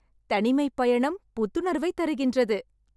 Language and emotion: Tamil, happy